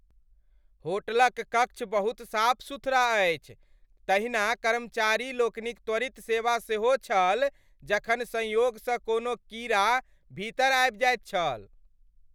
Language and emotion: Maithili, happy